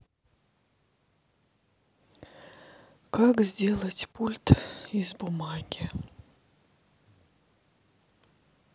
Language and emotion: Russian, sad